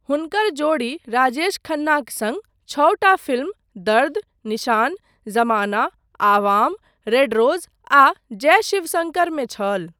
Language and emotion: Maithili, neutral